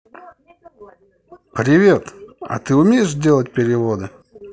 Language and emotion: Russian, positive